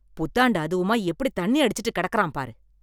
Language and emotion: Tamil, angry